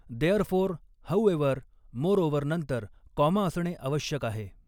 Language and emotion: Marathi, neutral